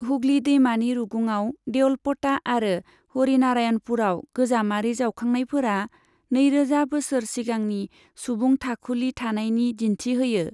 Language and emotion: Bodo, neutral